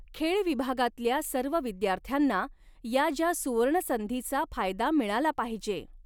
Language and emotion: Marathi, neutral